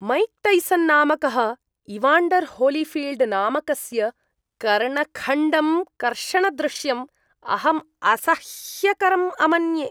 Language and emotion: Sanskrit, disgusted